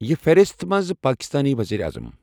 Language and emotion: Kashmiri, neutral